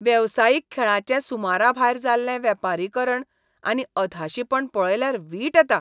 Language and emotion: Goan Konkani, disgusted